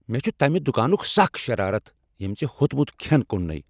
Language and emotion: Kashmiri, angry